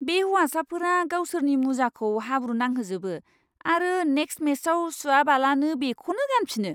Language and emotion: Bodo, disgusted